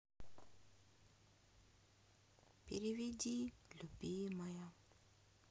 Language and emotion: Russian, sad